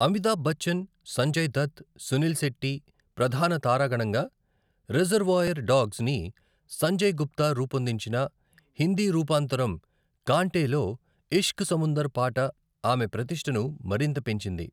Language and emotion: Telugu, neutral